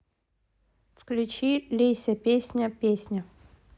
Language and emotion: Russian, neutral